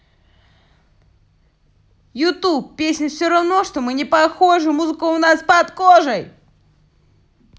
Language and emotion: Russian, positive